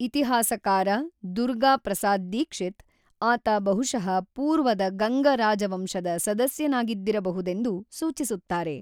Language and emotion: Kannada, neutral